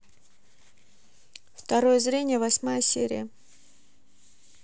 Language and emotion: Russian, neutral